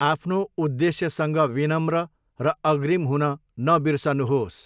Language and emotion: Nepali, neutral